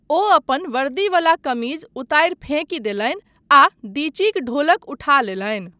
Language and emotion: Maithili, neutral